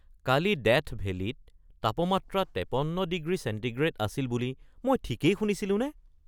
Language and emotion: Assamese, surprised